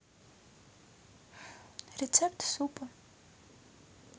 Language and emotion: Russian, neutral